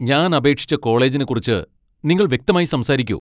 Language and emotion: Malayalam, angry